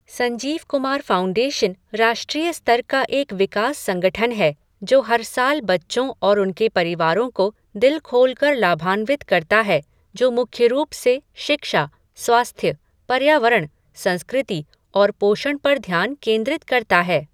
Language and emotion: Hindi, neutral